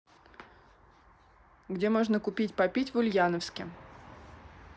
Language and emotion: Russian, neutral